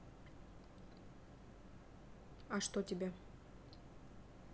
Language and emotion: Russian, neutral